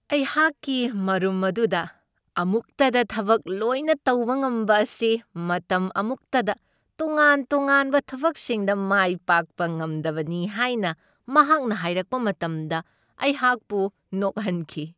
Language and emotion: Manipuri, happy